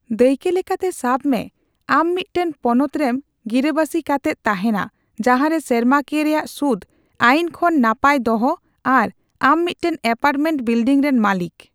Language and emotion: Santali, neutral